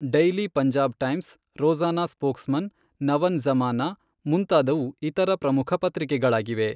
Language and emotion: Kannada, neutral